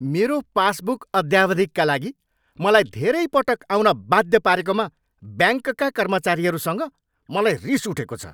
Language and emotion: Nepali, angry